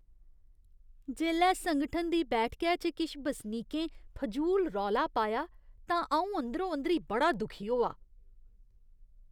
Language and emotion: Dogri, disgusted